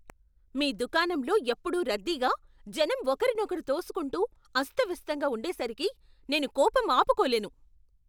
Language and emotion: Telugu, angry